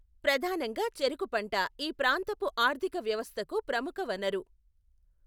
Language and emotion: Telugu, neutral